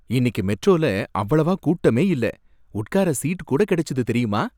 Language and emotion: Tamil, happy